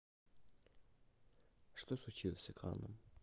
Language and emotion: Russian, neutral